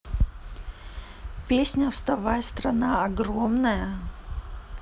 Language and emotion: Russian, neutral